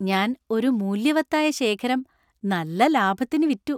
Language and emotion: Malayalam, happy